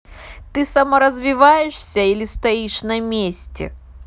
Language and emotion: Russian, neutral